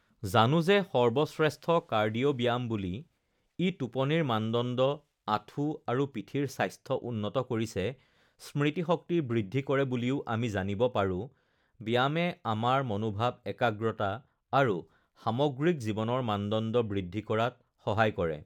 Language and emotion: Assamese, neutral